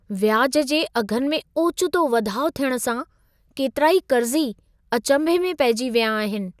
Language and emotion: Sindhi, surprised